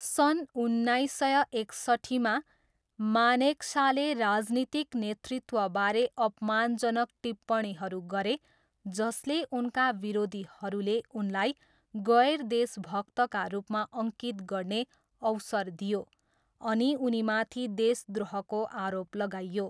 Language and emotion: Nepali, neutral